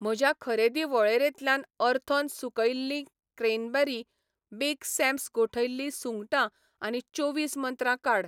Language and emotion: Goan Konkani, neutral